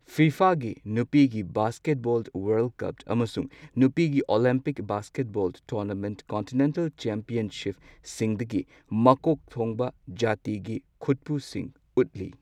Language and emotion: Manipuri, neutral